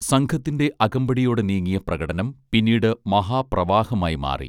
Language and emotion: Malayalam, neutral